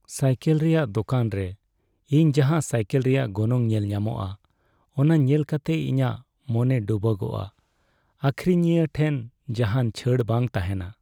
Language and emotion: Santali, sad